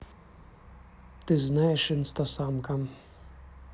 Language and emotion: Russian, neutral